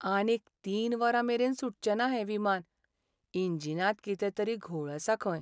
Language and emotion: Goan Konkani, sad